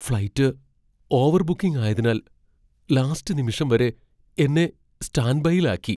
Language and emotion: Malayalam, fearful